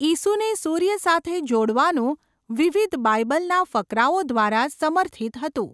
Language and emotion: Gujarati, neutral